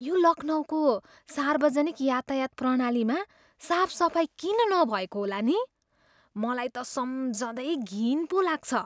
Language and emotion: Nepali, disgusted